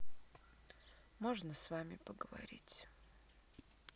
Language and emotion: Russian, sad